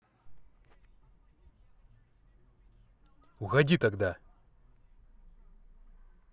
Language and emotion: Russian, angry